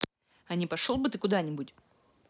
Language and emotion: Russian, angry